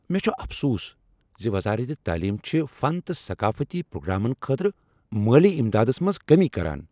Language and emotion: Kashmiri, angry